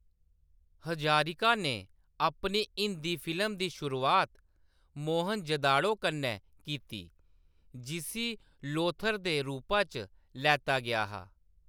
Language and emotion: Dogri, neutral